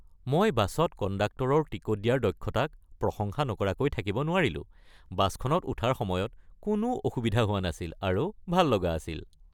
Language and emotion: Assamese, happy